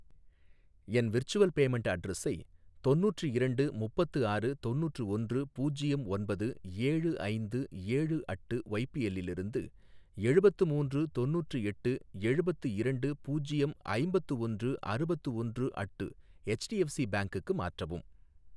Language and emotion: Tamil, neutral